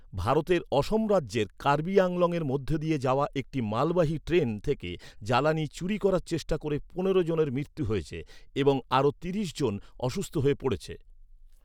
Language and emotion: Bengali, neutral